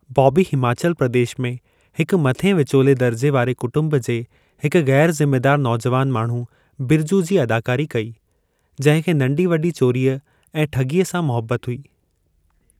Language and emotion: Sindhi, neutral